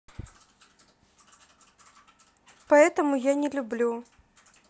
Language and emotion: Russian, sad